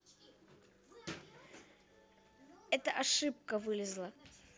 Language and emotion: Russian, neutral